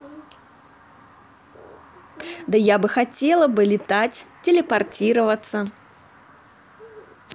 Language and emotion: Russian, positive